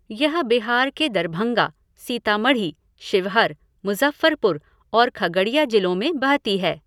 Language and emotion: Hindi, neutral